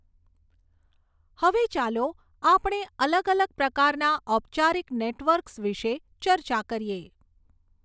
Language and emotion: Gujarati, neutral